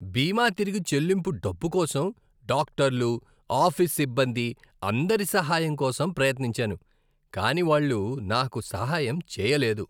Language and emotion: Telugu, disgusted